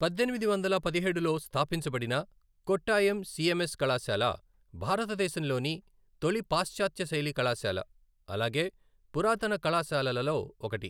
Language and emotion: Telugu, neutral